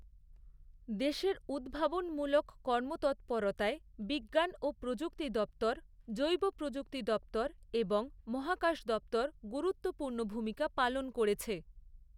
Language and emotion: Bengali, neutral